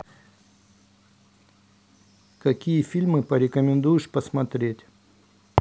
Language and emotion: Russian, neutral